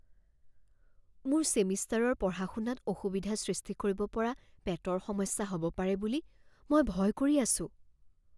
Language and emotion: Assamese, fearful